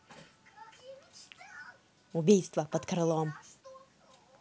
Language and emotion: Russian, angry